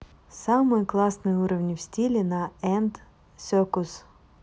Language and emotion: Russian, neutral